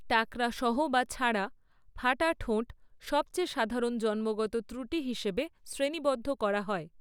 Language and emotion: Bengali, neutral